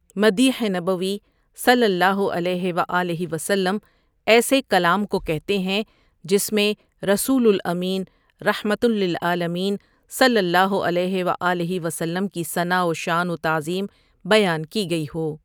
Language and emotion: Urdu, neutral